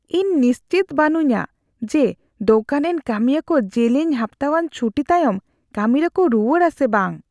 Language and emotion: Santali, fearful